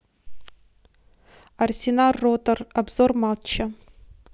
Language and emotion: Russian, neutral